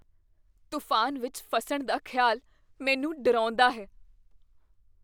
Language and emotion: Punjabi, fearful